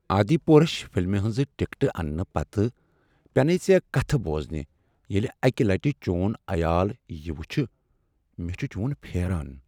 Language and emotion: Kashmiri, sad